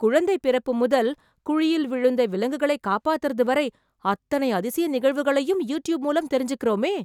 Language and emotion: Tamil, surprised